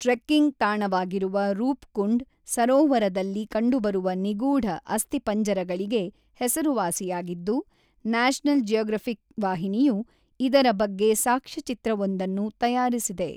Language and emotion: Kannada, neutral